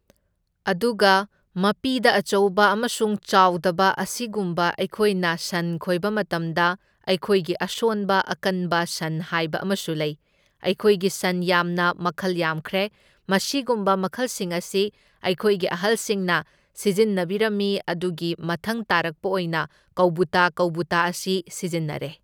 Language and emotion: Manipuri, neutral